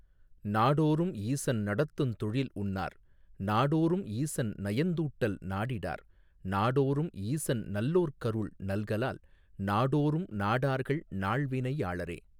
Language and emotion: Tamil, neutral